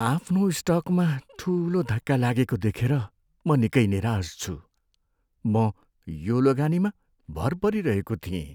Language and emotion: Nepali, sad